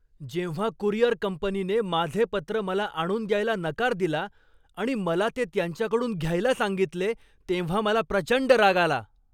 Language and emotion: Marathi, angry